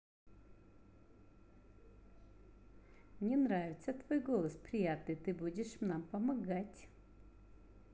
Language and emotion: Russian, positive